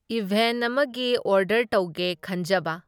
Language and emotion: Manipuri, neutral